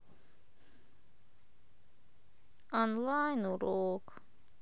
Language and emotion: Russian, sad